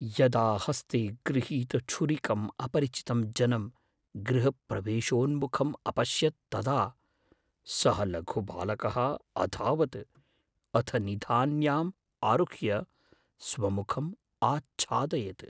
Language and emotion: Sanskrit, fearful